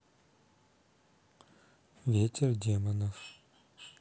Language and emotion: Russian, neutral